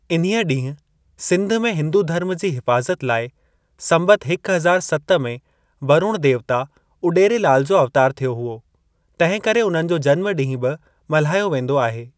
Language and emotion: Sindhi, neutral